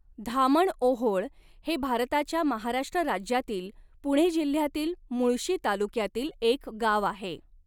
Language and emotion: Marathi, neutral